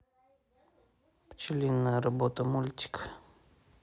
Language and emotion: Russian, neutral